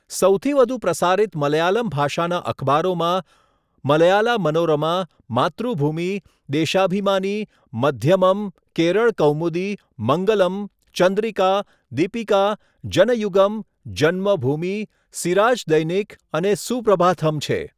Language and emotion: Gujarati, neutral